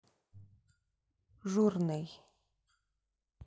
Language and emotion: Russian, neutral